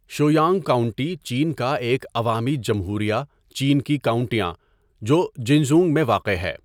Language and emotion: Urdu, neutral